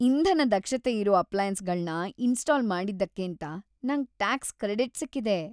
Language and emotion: Kannada, happy